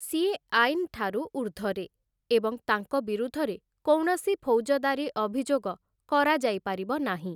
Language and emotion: Odia, neutral